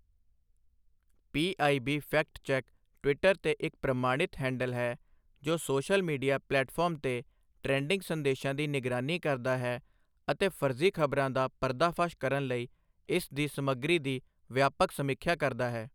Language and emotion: Punjabi, neutral